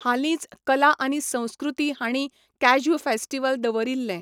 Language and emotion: Goan Konkani, neutral